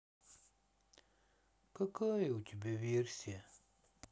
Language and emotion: Russian, sad